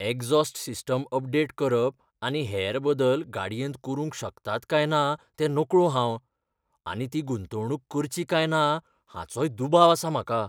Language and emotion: Goan Konkani, fearful